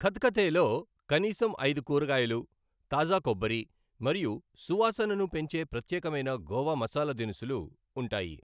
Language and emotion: Telugu, neutral